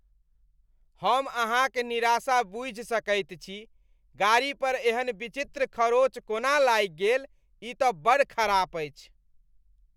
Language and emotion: Maithili, disgusted